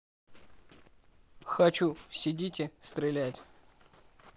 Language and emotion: Russian, neutral